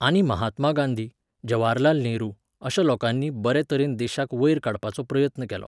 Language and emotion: Goan Konkani, neutral